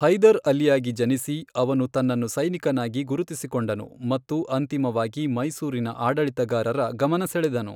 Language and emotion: Kannada, neutral